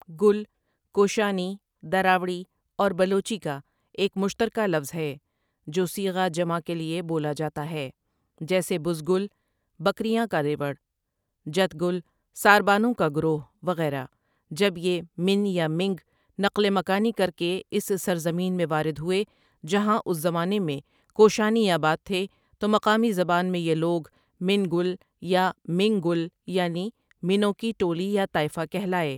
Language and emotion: Urdu, neutral